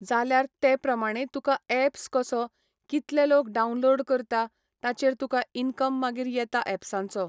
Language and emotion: Goan Konkani, neutral